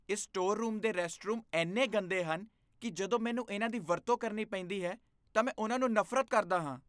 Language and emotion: Punjabi, disgusted